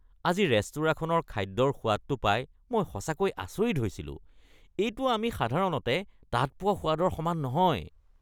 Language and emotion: Assamese, disgusted